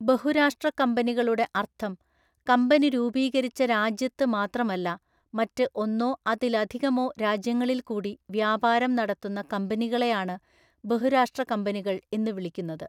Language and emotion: Malayalam, neutral